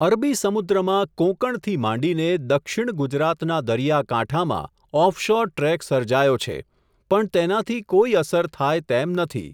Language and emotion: Gujarati, neutral